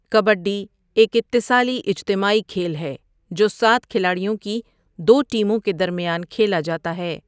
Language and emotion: Urdu, neutral